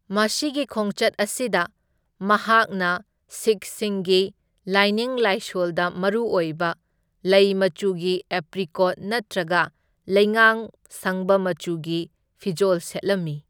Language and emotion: Manipuri, neutral